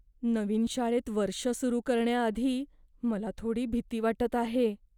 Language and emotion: Marathi, fearful